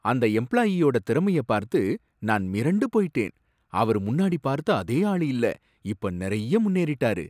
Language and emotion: Tamil, surprised